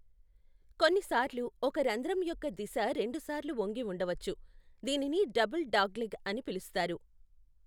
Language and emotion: Telugu, neutral